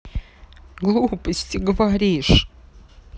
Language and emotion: Russian, sad